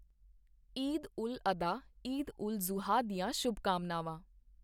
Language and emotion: Punjabi, neutral